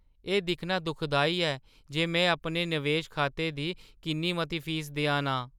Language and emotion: Dogri, sad